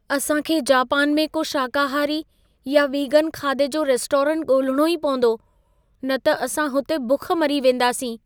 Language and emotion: Sindhi, fearful